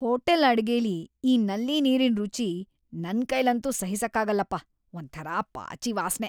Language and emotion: Kannada, disgusted